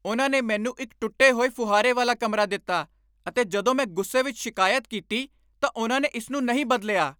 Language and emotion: Punjabi, angry